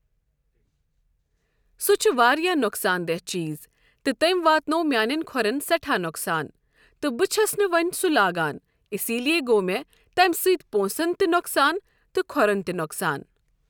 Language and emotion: Kashmiri, neutral